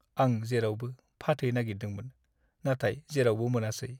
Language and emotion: Bodo, sad